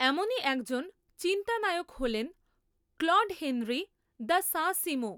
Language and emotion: Bengali, neutral